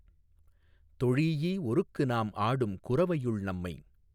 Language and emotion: Tamil, neutral